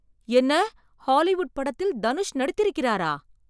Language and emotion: Tamil, surprised